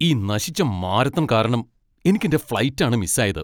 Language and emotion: Malayalam, angry